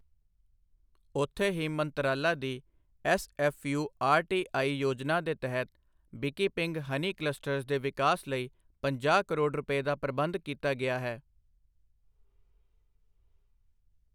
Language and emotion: Punjabi, neutral